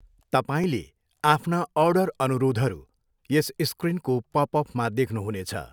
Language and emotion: Nepali, neutral